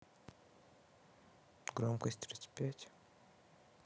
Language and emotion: Russian, neutral